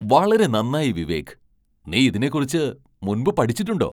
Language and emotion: Malayalam, surprised